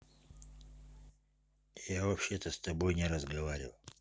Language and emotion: Russian, neutral